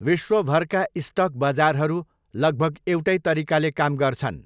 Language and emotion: Nepali, neutral